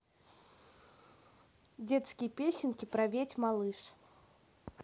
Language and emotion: Russian, neutral